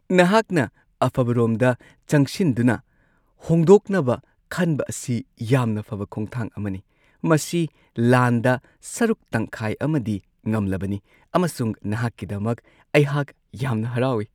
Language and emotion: Manipuri, happy